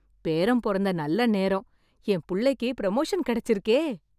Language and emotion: Tamil, happy